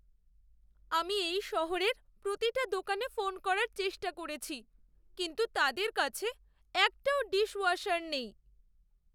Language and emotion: Bengali, sad